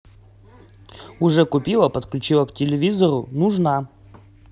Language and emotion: Russian, positive